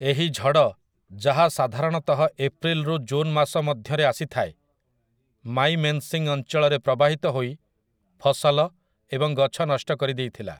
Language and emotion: Odia, neutral